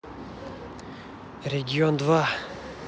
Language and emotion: Russian, neutral